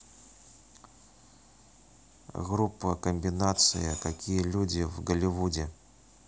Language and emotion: Russian, neutral